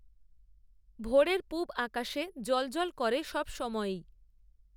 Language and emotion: Bengali, neutral